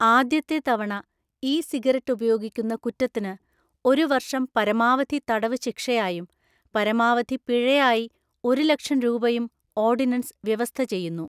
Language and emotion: Malayalam, neutral